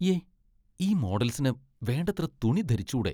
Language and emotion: Malayalam, disgusted